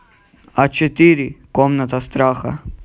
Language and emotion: Russian, neutral